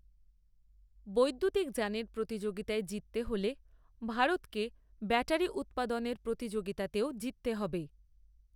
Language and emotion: Bengali, neutral